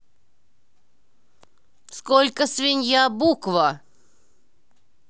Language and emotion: Russian, angry